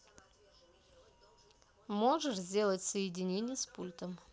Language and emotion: Russian, neutral